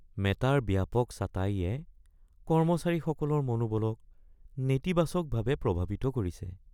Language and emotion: Assamese, sad